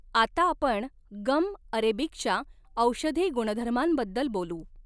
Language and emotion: Marathi, neutral